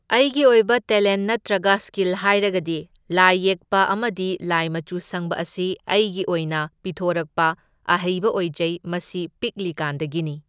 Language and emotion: Manipuri, neutral